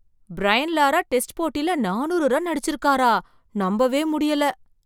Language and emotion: Tamil, surprised